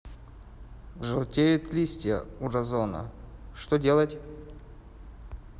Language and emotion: Russian, neutral